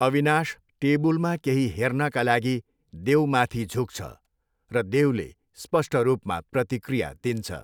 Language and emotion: Nepali, neutral